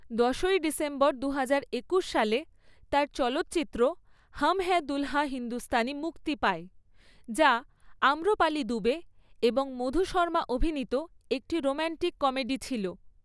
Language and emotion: Bengali, neutral